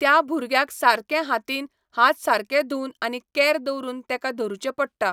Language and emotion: Goan Konkani, neutral